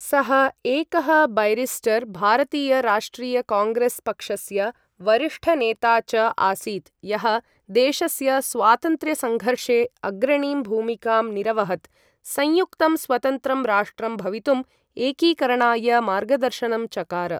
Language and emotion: Sanskrit, neutral